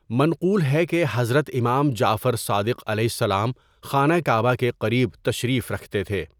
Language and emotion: Urdu, neutral